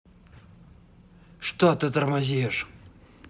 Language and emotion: Russian, angry